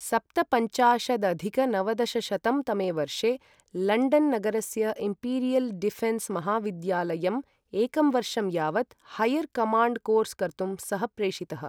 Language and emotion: Sanskrit, neutral